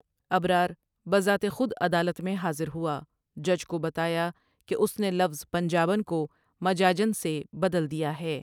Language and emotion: Urdu, neutral